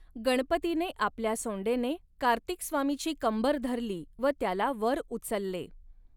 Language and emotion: Marathi, neutral